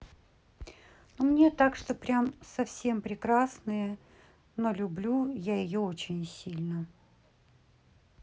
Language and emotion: Russian, neutral